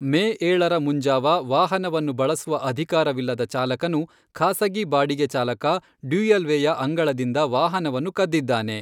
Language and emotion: Kannada, neutral